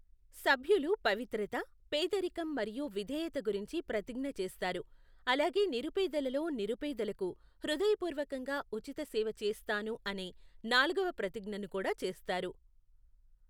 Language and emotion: Telugu, neutral